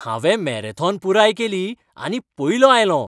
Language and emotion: Goan Konkani, happy